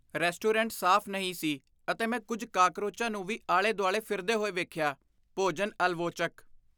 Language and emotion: Punjabi, disgusted